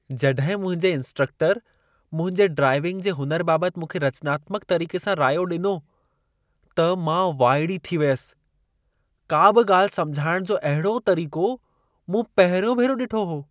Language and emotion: Sindhi, surprised